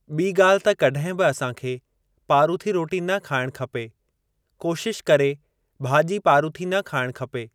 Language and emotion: Sindhi, neutral